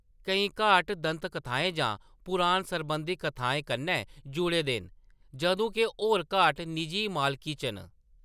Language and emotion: Dogri, neutral